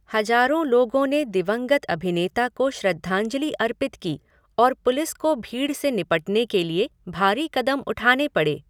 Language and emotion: Hindi, neutral